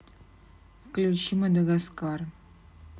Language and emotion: Russian, neutral